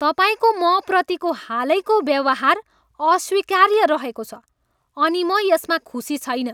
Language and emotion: Nepali, angry